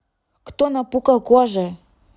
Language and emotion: Russian, neutral